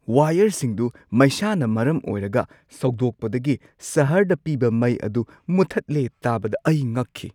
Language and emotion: Manipuri, surprised